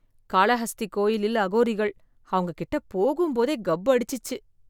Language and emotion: Tamil, disgusted